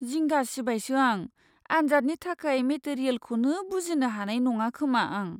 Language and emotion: Bodo, fearful